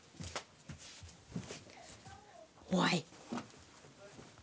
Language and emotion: Russian, neutral